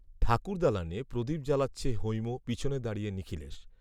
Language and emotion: Bengali, neutral